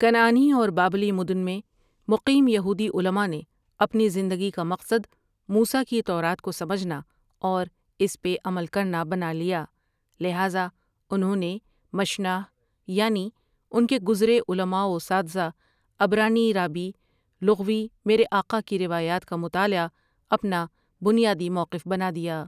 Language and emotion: Urdu, neutral